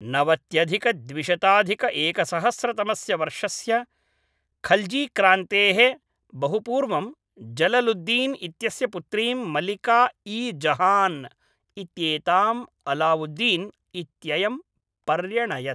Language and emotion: Sanskrit, neutral